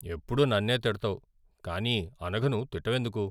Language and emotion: Telugu, sad